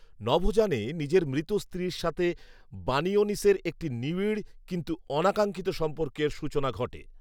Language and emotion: Bengali, neutral